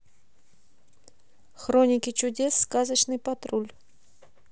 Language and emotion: Russian, neutral